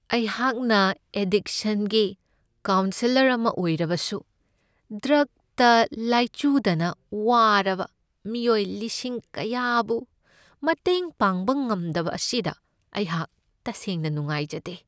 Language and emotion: Manipuri, sad